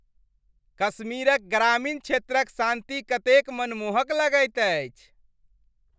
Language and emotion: Maithili, happy